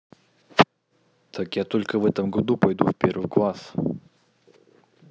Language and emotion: Russian, neutral